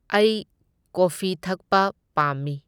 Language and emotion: Manipuri, neutral